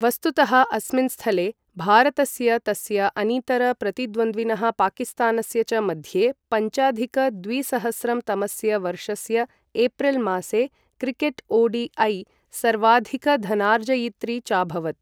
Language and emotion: Sanskrit, neutral